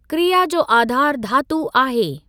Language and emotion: Sindhi, neutral